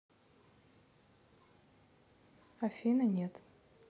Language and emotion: Russian, neutral